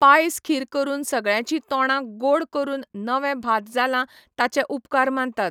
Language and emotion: Goan Konkani, neutral